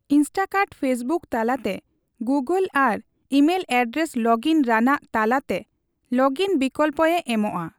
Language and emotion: Santali, neutral